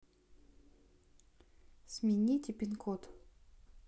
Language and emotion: Russian, neutral